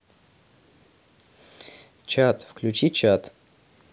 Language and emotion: Russian, neutral